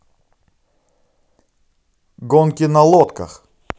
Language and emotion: Russian, positive